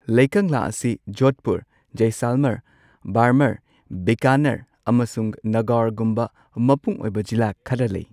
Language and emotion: Manipuri, neutral